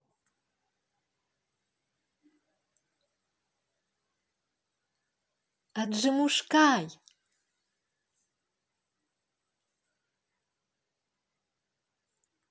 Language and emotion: Russian, positive